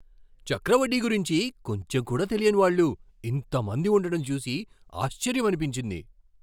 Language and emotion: Telugu, surprised